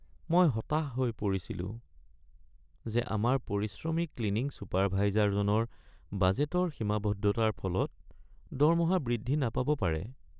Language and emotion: Assamese, sad